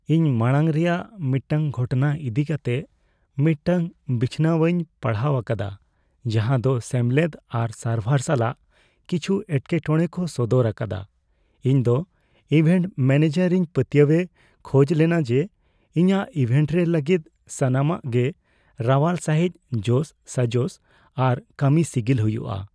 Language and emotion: Santali, fearful